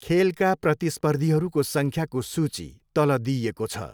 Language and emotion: Nepali, neutral